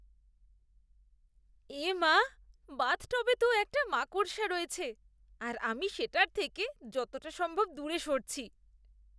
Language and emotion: Bengali, disgusted